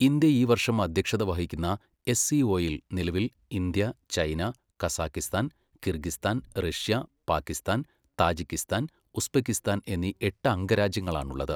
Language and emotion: Malayalam, neutral